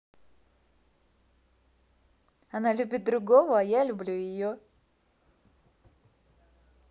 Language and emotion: Russian, positive